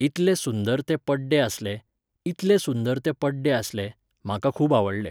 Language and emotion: Goan Konkani, neutral